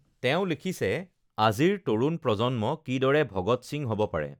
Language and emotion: Assamese, neutral